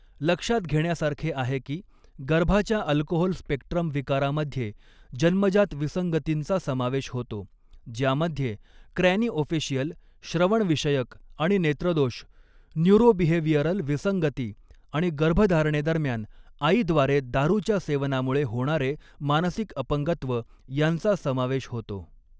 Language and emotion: Marathi, neutral